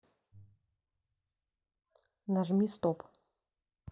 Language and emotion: Russian, neutral